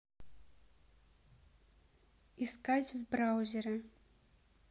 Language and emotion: Russian, neutral